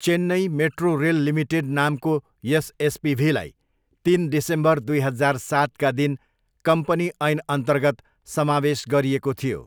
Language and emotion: Nepali, neutral